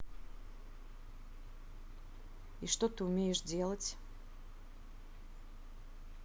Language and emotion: Russian, neutral